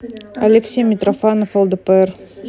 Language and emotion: Russian, neutral